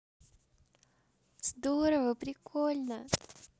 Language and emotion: Russian, positive